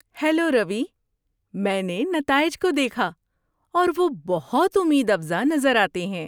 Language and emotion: Urdu, happy